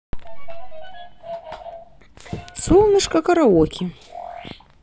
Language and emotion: Russian, positive